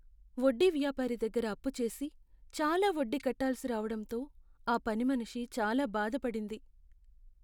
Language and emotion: Telugu, sad